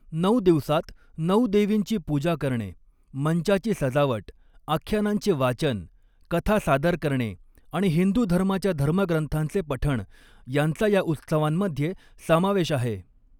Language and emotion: Marathi, neutral